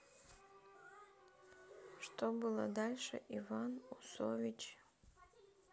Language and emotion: Russian, sad